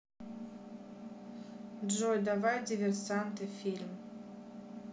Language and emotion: Russian, neutral